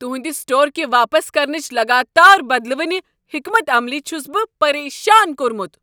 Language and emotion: Kashmiri, angry